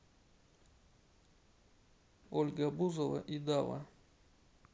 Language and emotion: Russian, neutral